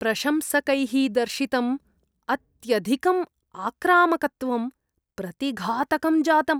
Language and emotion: Sanskrit, disgusted